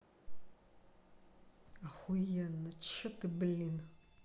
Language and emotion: Russian, angry